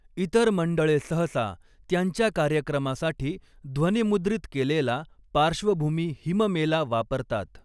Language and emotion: Marathi, neutral